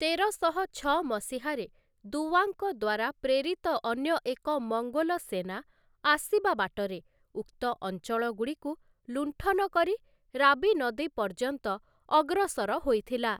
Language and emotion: Odia, neutral